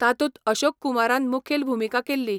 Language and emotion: Goan Konkani, neutral